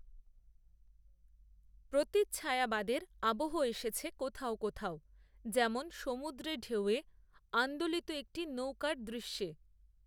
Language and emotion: Bengali, neutral